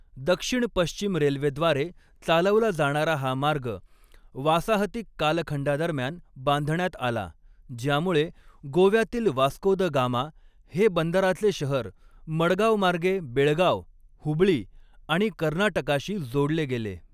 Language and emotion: Marathi, neutral